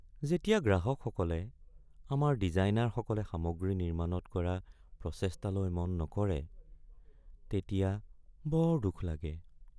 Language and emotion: Assamese, sad